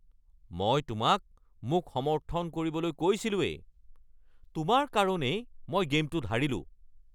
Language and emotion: Assamese, angry